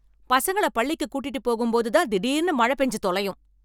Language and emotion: Tamil, angry